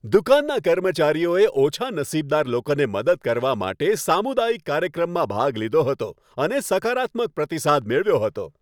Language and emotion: Gujarati, happy